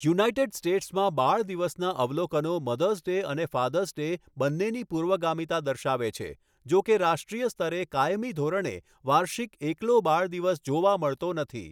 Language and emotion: Gujarati, neutral